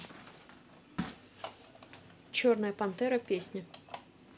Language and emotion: Russian, neutral